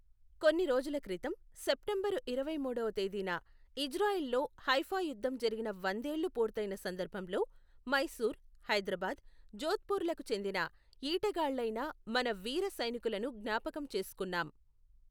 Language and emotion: Telugu, neutral